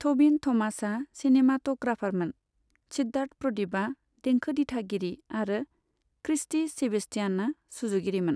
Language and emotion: Bodo, neutral